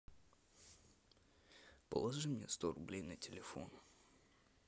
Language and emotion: Russian, sad